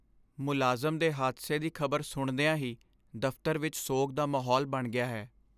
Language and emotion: Punjabi, sad